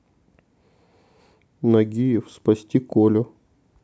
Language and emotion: Russian, neutral